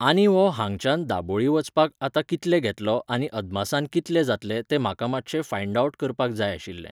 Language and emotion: Goan Konkani, neutral